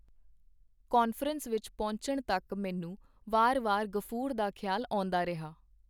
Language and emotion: Punjabi, neutral